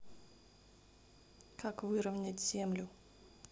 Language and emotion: Russian, neutral